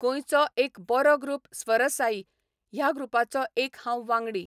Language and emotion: Goan Konkani, neutral